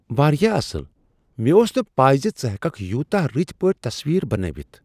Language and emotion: Kashmiri, surprised